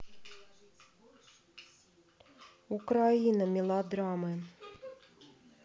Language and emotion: Russian, neutral